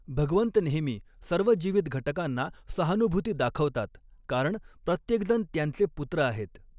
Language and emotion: Marathi, neutral